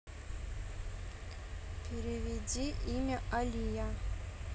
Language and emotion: Russian, neutral